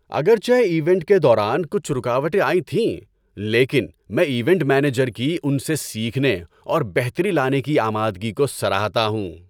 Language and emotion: Urdu, happy